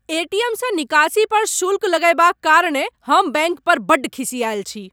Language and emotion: Maithili, angry